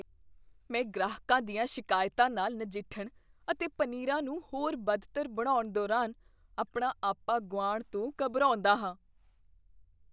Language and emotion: Punjabi, fearful